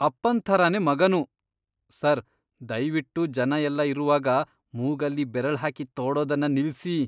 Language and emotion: Kannada, disgusted